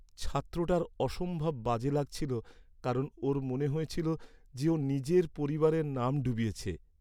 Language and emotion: Bengali, sad